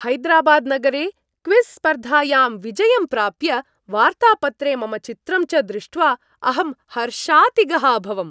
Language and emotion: Sanskrit, happy